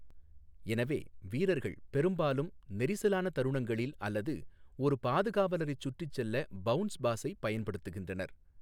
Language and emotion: Tamil, neutral